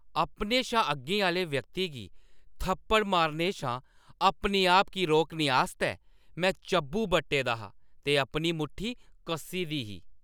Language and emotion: Dogri, angry